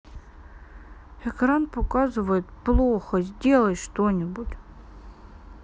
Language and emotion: Russian, sad